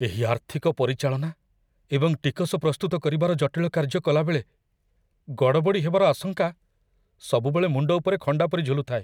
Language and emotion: Odia, fearful